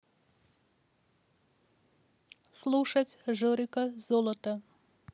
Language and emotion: Russian, neutral